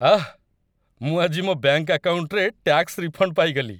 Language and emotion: Odia, happy